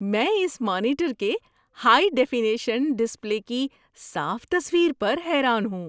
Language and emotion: Urdu, surprised